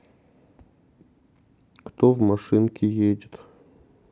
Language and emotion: Russian, sad